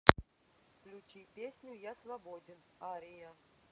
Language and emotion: Russian, neutral